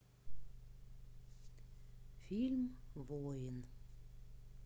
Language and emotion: Russian, neutral